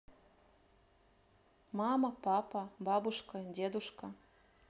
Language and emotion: Russian, neutral